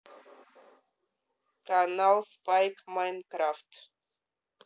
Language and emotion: Russian, neutral